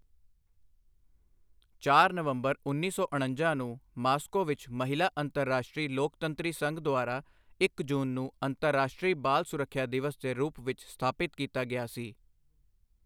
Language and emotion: Punjabi, neutral